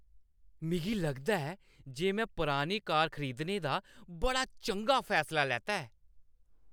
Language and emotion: Dogri, happy